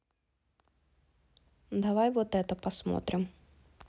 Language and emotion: Russian, neutral